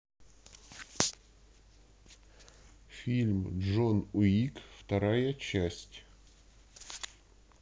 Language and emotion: Russian, neutral